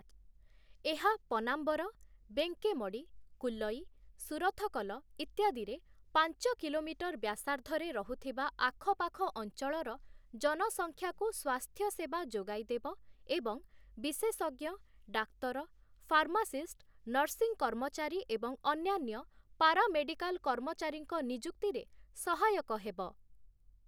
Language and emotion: Odia, neutral